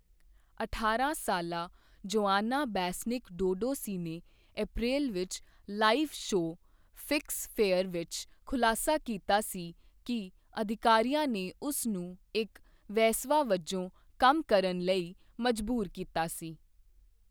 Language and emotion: Punjabi, neutral